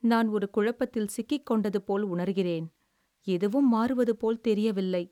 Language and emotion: Tamil, sad